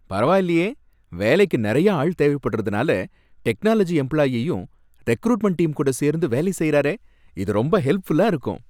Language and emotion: Tamil, happy